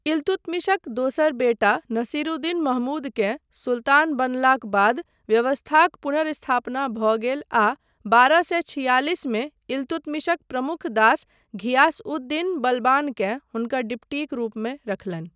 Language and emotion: Maithili, neutral